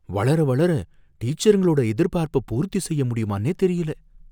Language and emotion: Tamil, fearful